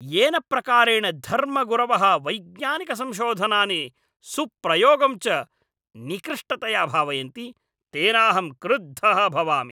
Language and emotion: Sanskrit, angry